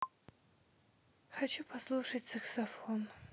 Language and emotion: Russian, sad